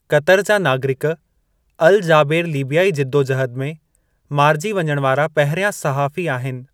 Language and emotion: Sindhi, neutral